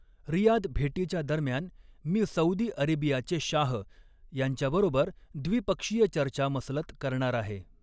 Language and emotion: Marathi, neutral